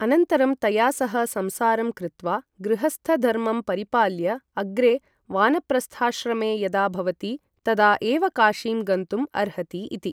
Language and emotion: Sanskrit, neutral